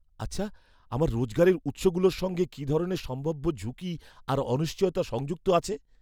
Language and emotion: Bengali, fearful